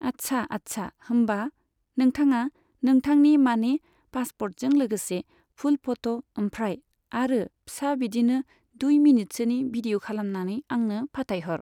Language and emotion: Bodo, neutral